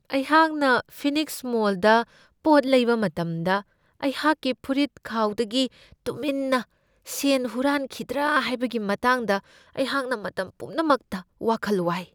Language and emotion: Manipuri, fearful